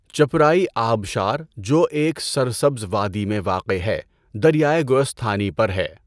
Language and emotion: Urdu, neutral